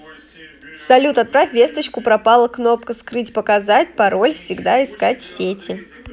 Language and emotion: Russian, neutral